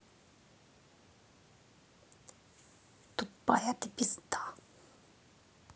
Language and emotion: Russian, angry